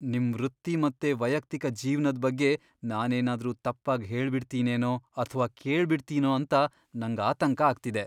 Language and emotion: Kannada, fearful